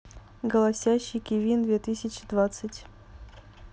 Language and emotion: Russian, neutral